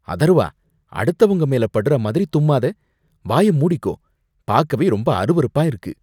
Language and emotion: Tamil, disgusted